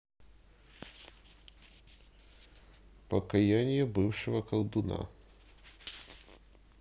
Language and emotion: Russian, neutral